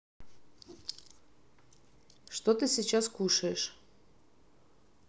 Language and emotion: Russian, neutral